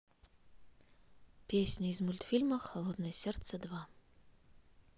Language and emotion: Russian, neutral